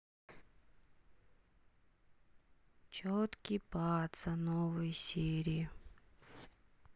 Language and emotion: Russian, sad